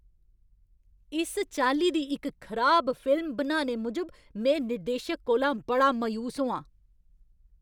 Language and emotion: Dogri, angry